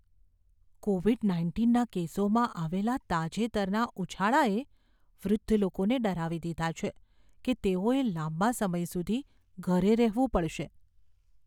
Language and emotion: Gujarati, fearful